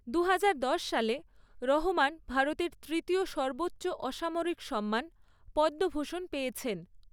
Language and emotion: Bengali, neutral